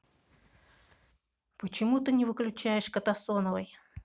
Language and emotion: Russian, neutral